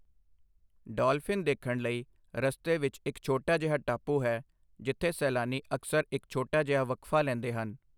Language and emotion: Punjabi, neutral